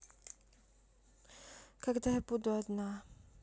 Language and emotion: Russian, sad